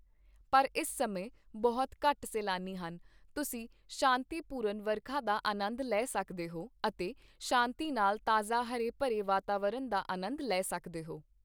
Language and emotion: Punjabi, neutral